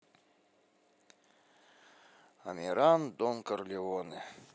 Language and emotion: Russian, sad